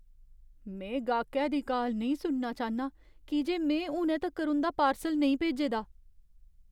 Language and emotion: Dogri, fearful